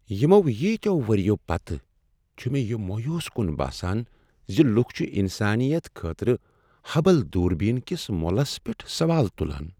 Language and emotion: Kashmiri, sad